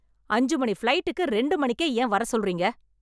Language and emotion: Tamil, angry